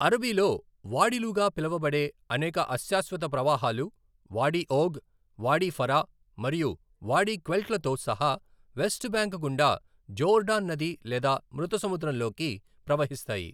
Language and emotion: Telugu, neutral